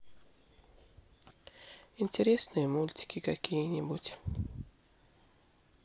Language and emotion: Russian, sad